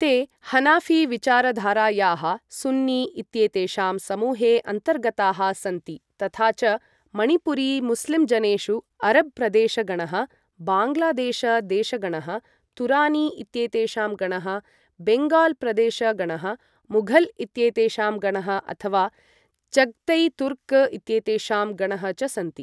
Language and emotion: Sanskrit, neutral